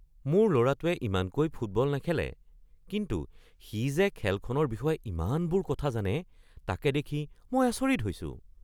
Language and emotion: Assamese, surprised